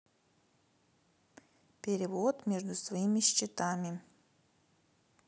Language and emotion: Russian, neutral